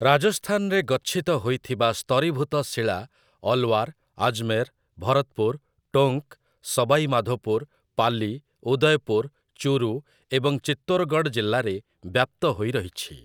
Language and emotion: Odia, neutral